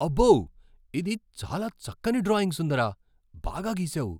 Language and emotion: Telugu, surprised